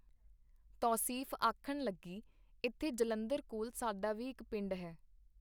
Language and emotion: Punjabi, neutral